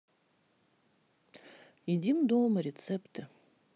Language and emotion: Russian, neutral